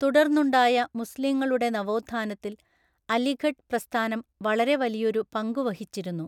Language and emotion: Malayalam, neutral